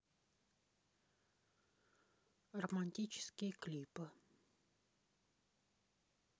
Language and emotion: Russian, neutral